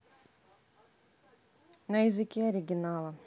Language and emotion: Russian, neutral